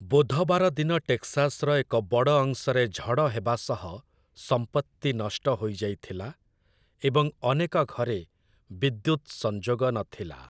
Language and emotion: Odia, neutral